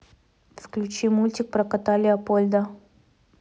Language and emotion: Russian, neutral